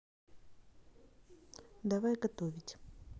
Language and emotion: Russian, neutral